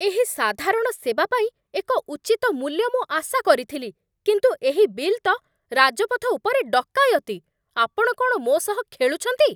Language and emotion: Odia, angry